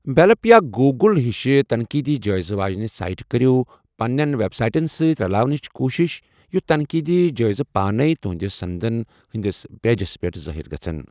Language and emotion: Kashmiri, neutral